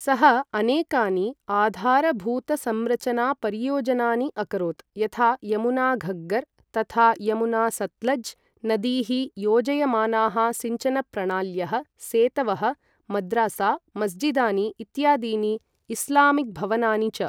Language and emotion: Sanskrit, neutral